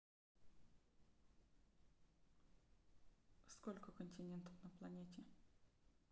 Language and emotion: Russian, neutral